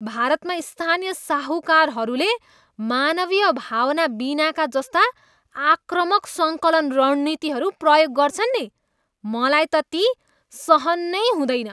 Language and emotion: Nepali, disgusted